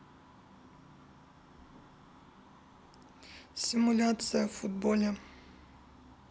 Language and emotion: Russian, neutral